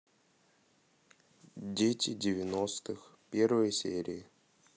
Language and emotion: Russian, neutral